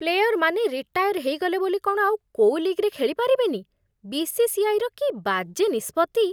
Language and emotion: Odia, disgusted